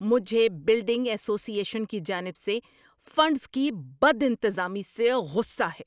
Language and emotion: Urdu, angry